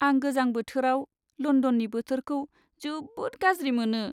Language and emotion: Bodo, sad